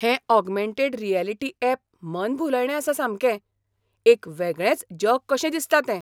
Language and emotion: Goan Konkani, surprised